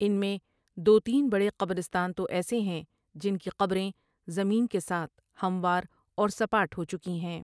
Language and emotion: Urdu, neutral